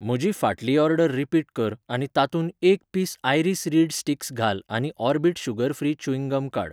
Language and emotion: Goan Konkani, neutral